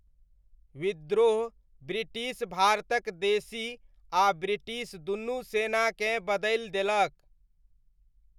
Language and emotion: Maithili, neutral